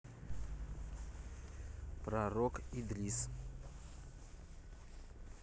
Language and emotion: Russian, neutral